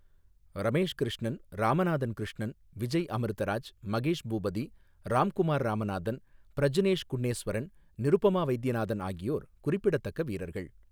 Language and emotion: Tamil, neutral